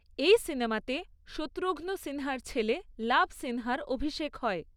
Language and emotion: Bengali, neutral